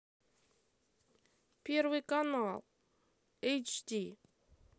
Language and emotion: Russian, sad